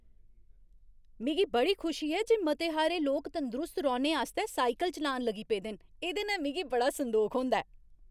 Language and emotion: Dogri, happy